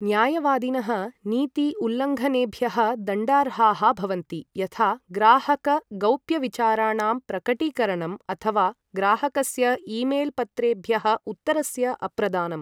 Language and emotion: Sanskrit, neutral